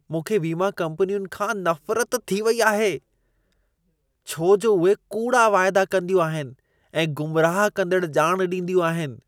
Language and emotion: Sindhi, disgusted